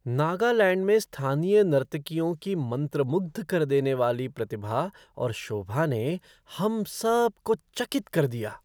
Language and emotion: Hindi, surprised